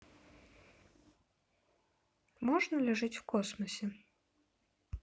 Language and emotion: Russian, neutral